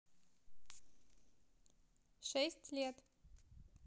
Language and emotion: Russian, neutral